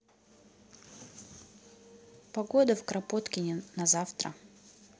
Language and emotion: Russian, neutral